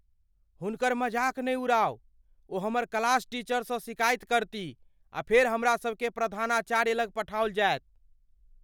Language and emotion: Maithili, fearful